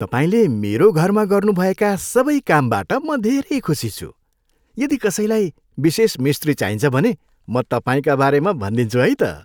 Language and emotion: Nepali, happy